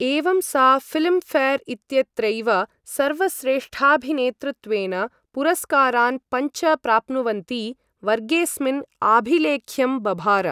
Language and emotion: Sanskrit, neutral